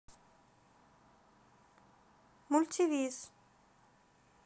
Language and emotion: Russian, neutral